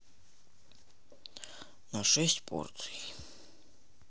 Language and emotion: Russian, neutral